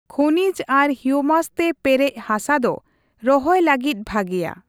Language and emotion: Santali, neutral